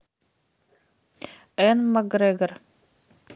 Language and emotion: Russian, neutral